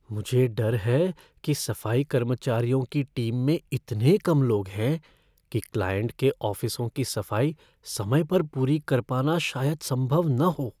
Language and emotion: Hindi, fearful